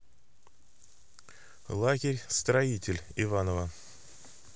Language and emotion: Russian, neutral